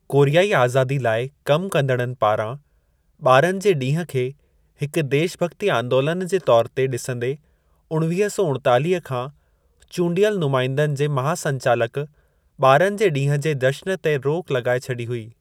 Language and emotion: Sindhi, neutral